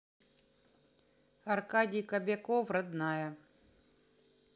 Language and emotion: Russian, neutral